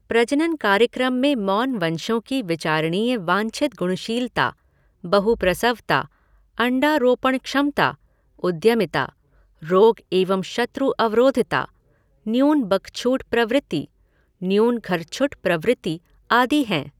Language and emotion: Hindi, neutral